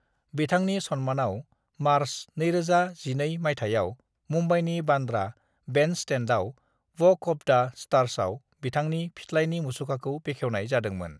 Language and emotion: Bodo, neutral